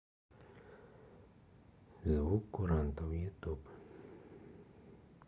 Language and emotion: Russian, neutral